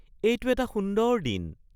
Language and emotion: Assamese, happy